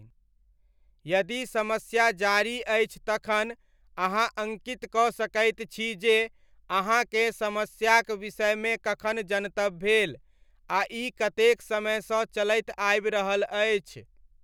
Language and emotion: Maithili, neutral